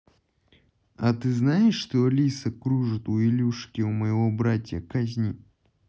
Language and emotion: Russian, neutral